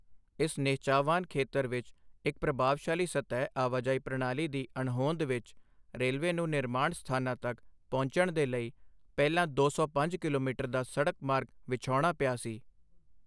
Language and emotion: Punjabi, neutral